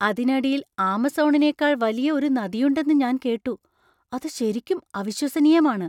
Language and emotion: Malayalam, surprised